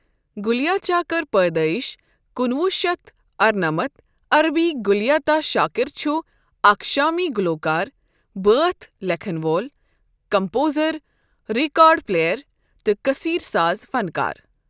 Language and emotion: Kashmiri, neutral